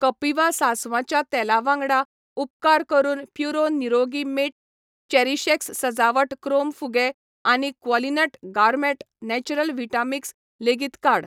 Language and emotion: Goan Konkani, neutral